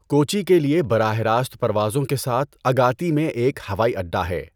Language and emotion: Urdu, neutral